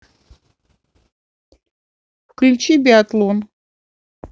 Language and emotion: Russian, neutral